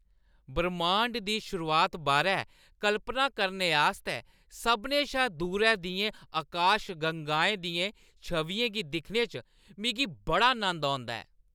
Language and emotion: Dogri, happy